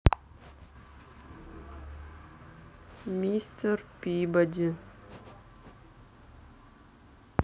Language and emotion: Russian, neutral